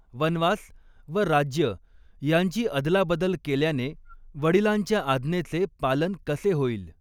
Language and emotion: Marathi, neutral